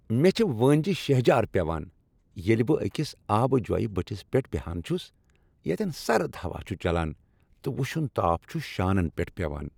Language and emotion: Kashmiri, happy